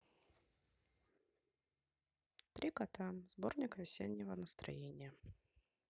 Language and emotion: Russian, neutral